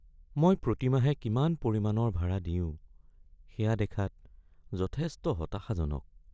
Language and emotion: Assamese, sad